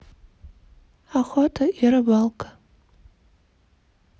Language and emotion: Russian, neutral